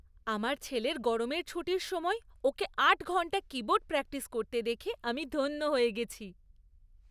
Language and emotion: Bengali, happy